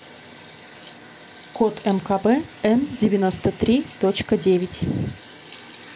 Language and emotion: Russian, neutral